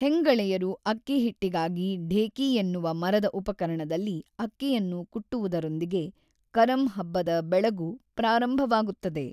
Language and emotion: Kannada, neutral